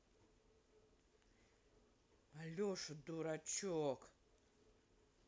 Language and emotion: Russian, angry